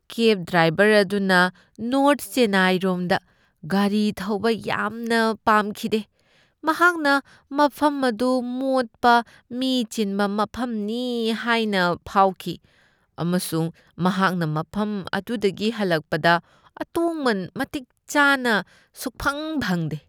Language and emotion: Manipuri, disgusted